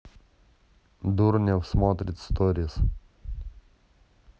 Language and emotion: Russian, neutral